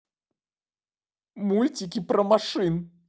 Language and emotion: Russian, sad